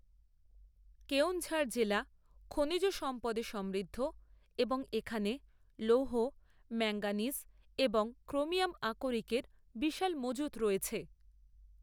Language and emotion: Bengali, neutral